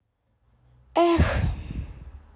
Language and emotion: Russian, sad